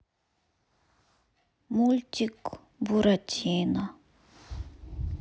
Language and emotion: Russian, sad